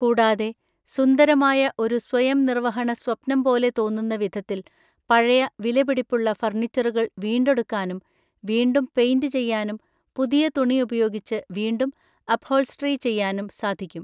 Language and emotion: Malayalam, neutral